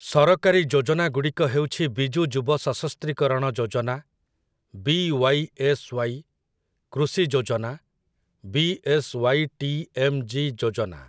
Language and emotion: Odia, neutral